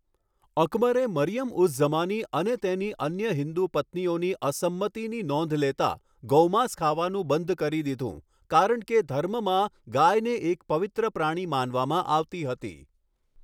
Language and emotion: Gujarati, neutral